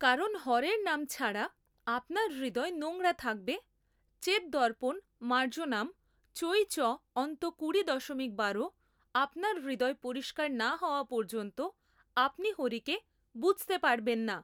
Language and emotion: Bengali, neutral